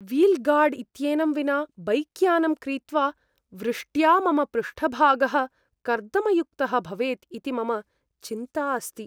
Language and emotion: Sanskrit, fearful